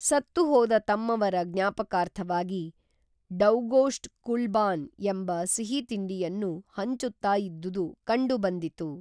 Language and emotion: Kannada, neutral